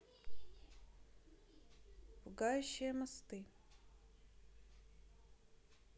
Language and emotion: Russian, neutral